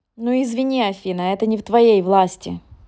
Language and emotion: Russian, angry